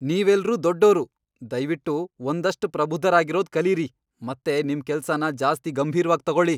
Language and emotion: Kannada, angry